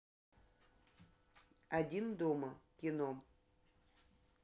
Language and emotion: Russian, neutral